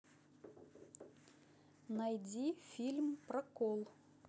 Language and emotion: Russian, neutral